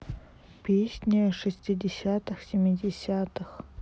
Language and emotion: Russian, neutral